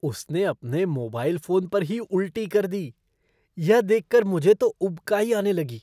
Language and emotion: Hindi, disgusted